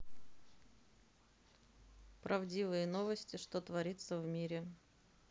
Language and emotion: Russian, neutral